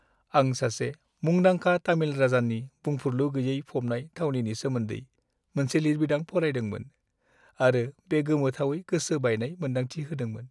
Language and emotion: Bodo, sad